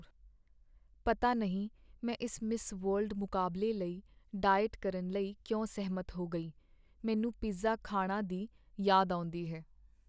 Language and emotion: Punjabi, sad